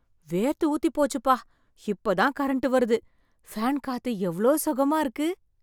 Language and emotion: Tamil, happy